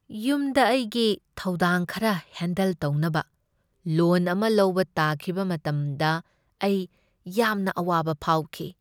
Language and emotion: Manipuri, sad